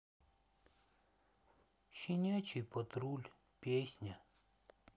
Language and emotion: Russian, sad